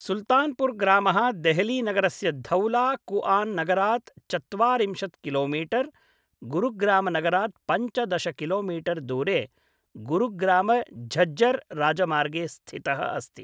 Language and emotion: Sanskrit, neutral